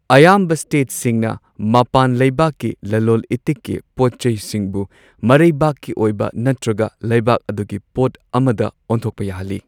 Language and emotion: Manipuri, neutral